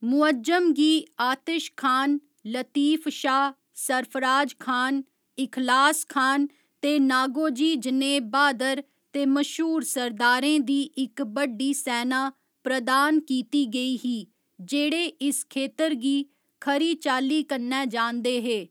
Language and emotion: Dogri, neutral